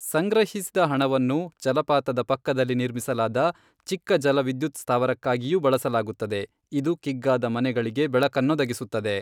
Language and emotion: Kannada, neutral